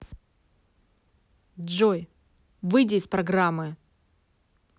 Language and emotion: Russian, angry